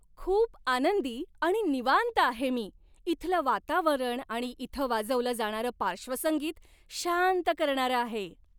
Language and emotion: Marathi, happy